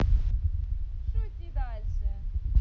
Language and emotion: Russian, positive